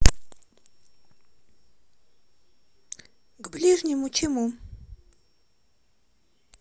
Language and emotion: Russian, neutral